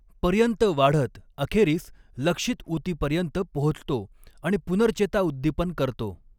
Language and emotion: Marathi, neutral